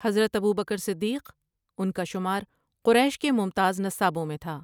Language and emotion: Urdu, neutral